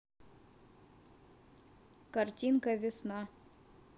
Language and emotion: Russian, neutral